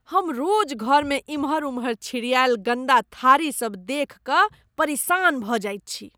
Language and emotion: Maithili, disgusted